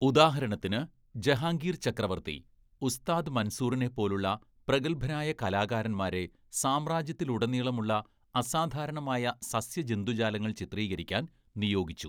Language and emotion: Malayalam, neutral